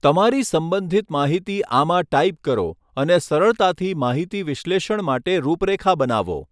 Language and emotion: Gujarati, neutral